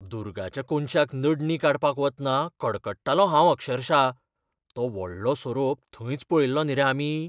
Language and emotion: Goan Konkani, fearful